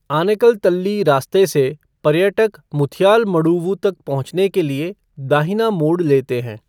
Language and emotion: Hindi, neutral